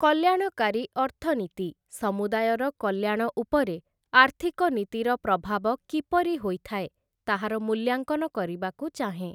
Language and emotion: Odia, neutral